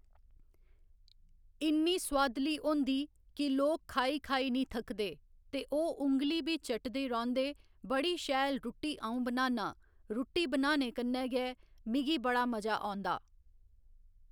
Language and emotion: Dogri, neutral